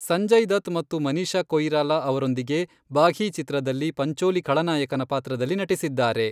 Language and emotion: Kannada, neutral